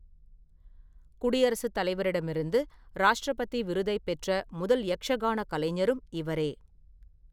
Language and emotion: Tamil, neutral